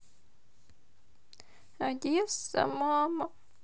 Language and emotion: Russian, sad